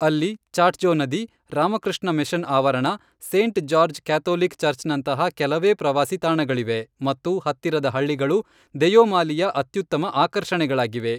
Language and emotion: Kannada, neutral